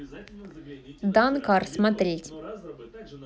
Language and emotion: Russian, neutral